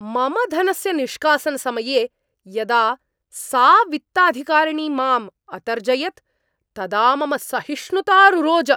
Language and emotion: Sanskrit, angry